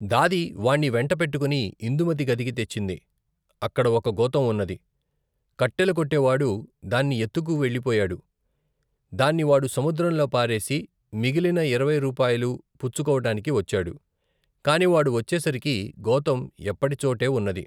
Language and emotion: Telugu, neutral